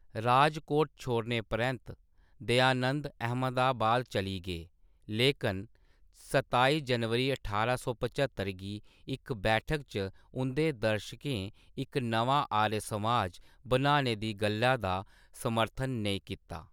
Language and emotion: Dogri, neutral